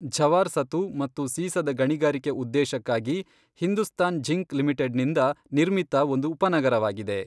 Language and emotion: Kannada, neutral